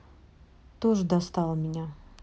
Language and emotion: Russian, neutral